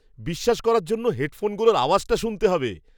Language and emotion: Bengali, surprised